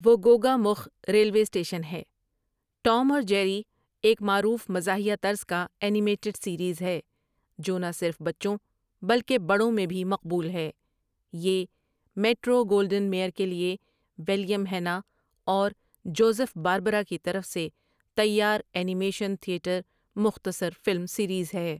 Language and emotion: Urdu, neutral